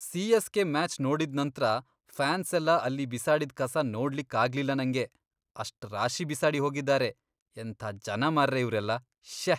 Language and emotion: Kannada, disgusted